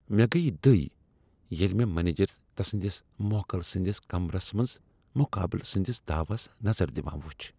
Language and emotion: Kashmiri, disgusted